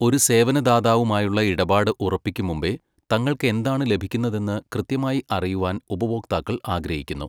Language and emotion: Malayalam, neutral